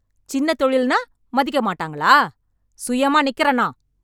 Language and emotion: Tamil, angry